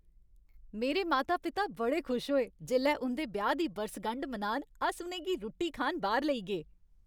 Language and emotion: Dogri, happy